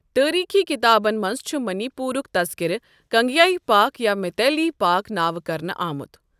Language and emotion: Kashmiri, neutral